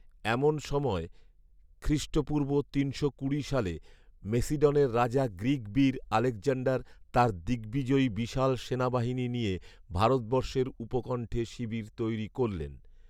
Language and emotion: Bengali, neutral